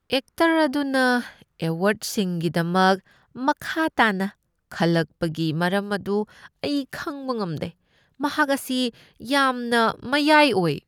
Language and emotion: Manipuri, disgusted